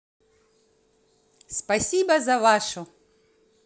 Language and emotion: Russian, positive